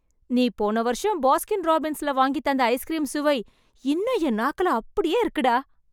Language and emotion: Tamil, happy